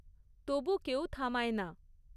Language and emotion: Bengali, neutral